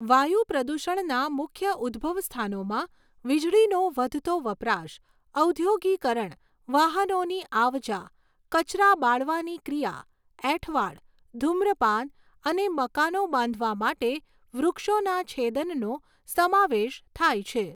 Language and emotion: Gujarati, neutral